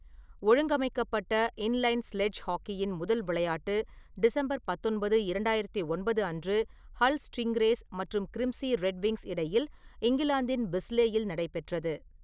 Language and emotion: Tamil, neutral